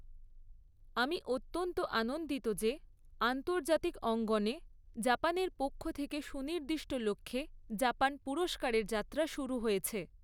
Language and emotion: Bengali, neutral